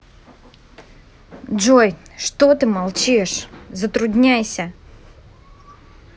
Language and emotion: Russian, angry